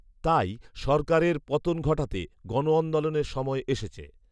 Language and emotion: Bengali, neutral